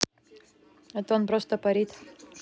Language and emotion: Russian, neutral